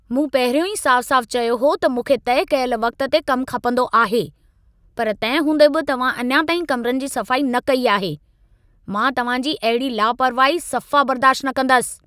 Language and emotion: Sindhi, angry